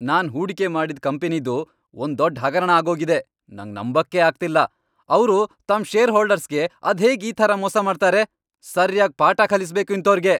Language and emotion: Kannada, angry